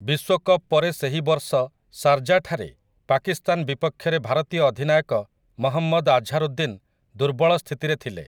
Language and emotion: Odia, neutral